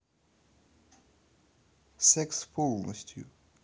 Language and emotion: Russian, neutral